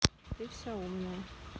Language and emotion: Russian, neutral